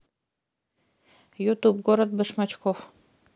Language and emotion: Russian, neutral